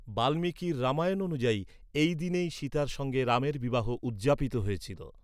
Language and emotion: Bengali, neutral